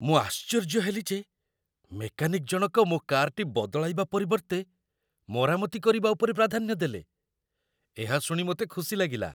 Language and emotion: Odia, surprised